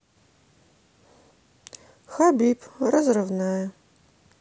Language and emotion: Russian, neutral